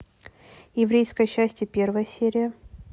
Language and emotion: Russian, neutral